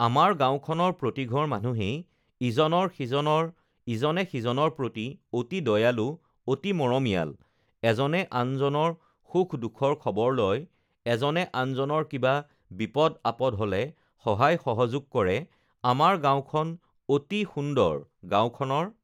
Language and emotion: Assamese, neutral